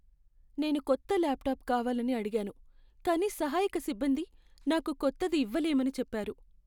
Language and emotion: Telugu, sad